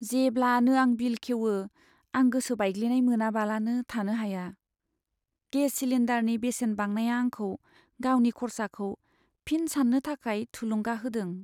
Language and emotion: Bodo, sad